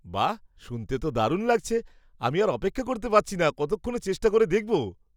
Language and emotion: Bengali, surprised